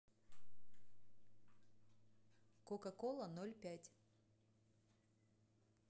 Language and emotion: Russian, neutral